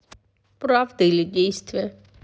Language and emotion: Russian, sad